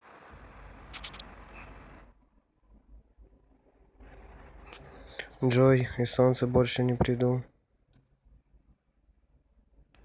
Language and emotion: Russian, neutral